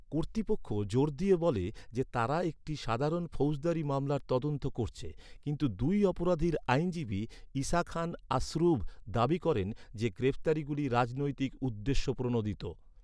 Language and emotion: Bengali, neutral